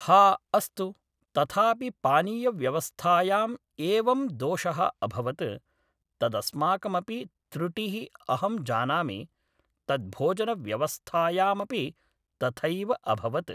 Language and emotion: Sanskrit, neutral